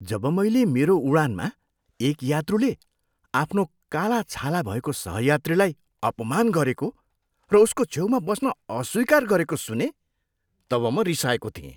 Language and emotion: Nepali, disgusted